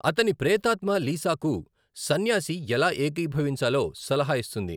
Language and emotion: Telugu, neutral